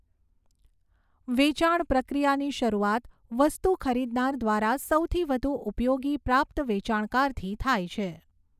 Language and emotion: Gujarati, neutral